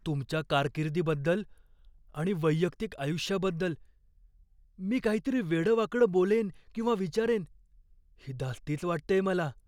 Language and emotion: Marathi, fearful